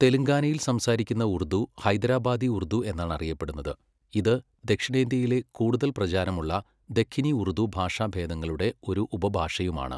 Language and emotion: Malayalam, neutral